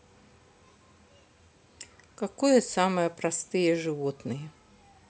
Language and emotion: Russian, neutral